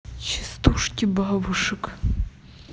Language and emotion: Russian, neutral